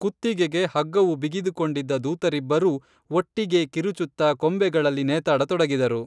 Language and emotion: Kannada, neutral